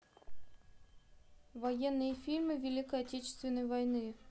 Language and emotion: Russian, neutral